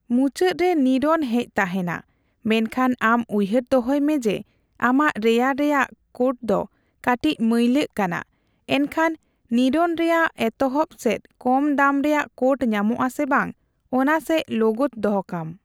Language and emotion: Santali, neutral